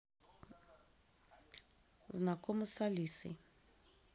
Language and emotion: Russian, neutral